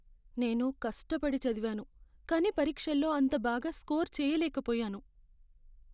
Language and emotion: Telugu, sad